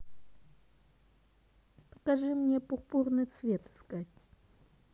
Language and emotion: Russian, neutral